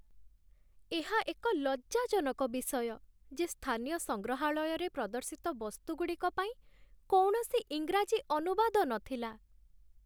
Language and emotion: Odia, sad